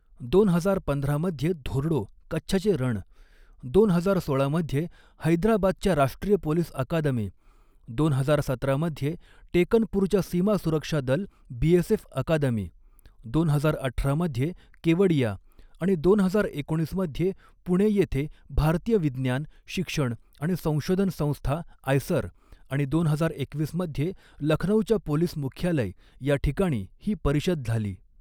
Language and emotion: Marathi, neutral